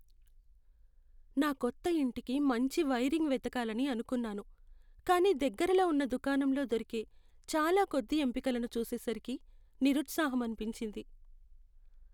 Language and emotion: Telugu, sad